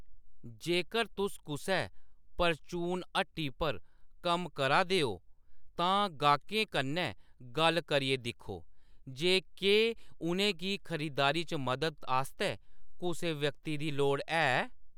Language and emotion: Dogri, neutral